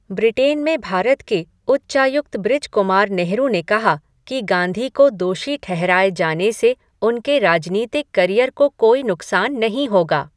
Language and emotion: Hindi, neutral